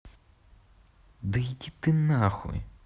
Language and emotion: Russian, angry